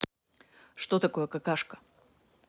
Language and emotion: Russian, neutral